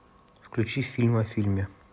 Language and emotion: Russian, neutral